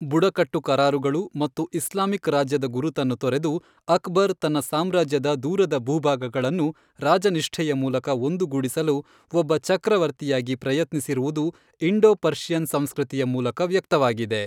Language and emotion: Kannada, neutral